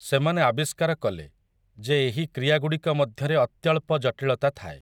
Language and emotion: Odia, neutral